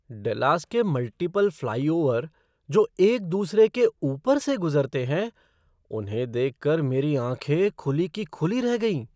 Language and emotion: Hindi, surprised